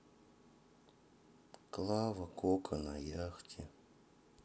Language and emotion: Russian, sad